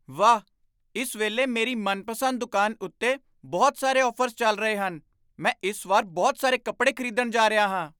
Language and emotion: Punjabi, surprised